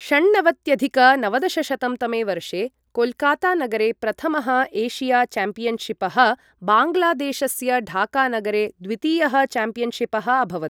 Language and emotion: Sanskrit, neutral